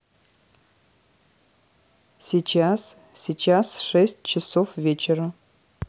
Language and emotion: Russian, neutral